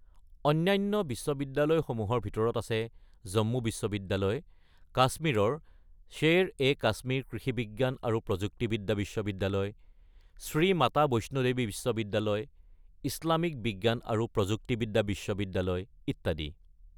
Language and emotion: Assamese, neutral